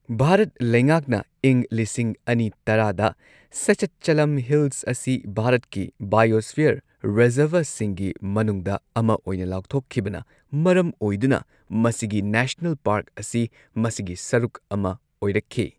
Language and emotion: Manipuri, neutral